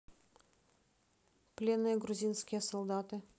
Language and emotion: Russian, neutral